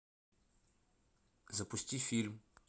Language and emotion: Russian, neutral